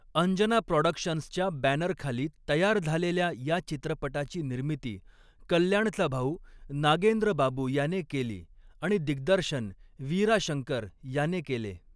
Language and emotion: Marathi, neutral